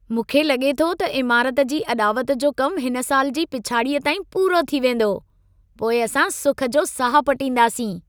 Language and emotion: Sindhi, happy